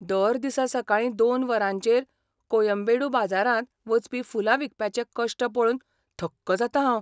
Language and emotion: Goan Konkani, surprised